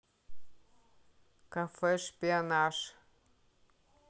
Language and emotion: Russian, neutral